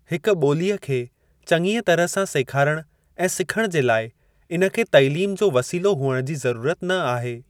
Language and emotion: Sindhi, neutral